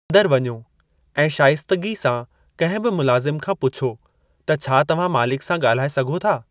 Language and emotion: Sindhi, neutral